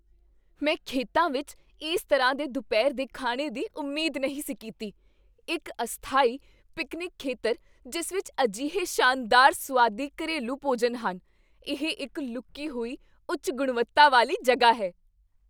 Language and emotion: Punjabi, surprised